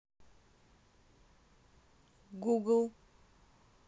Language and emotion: Russian, neutral